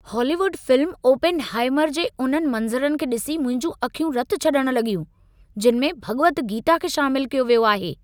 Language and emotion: Sindhi, angry